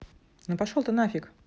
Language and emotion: Russian, neutral